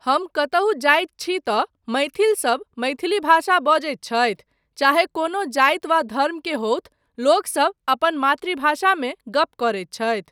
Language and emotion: Maithili, neutral